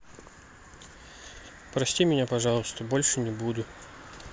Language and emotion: Russian, sad